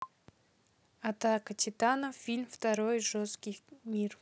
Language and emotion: Russian, neutral